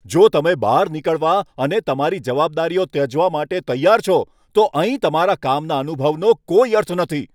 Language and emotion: Gujarati, angry